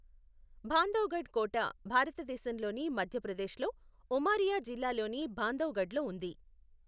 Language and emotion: Telugu, neutral